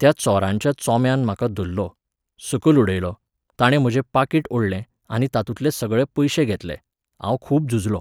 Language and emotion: Goan Konkani, neutral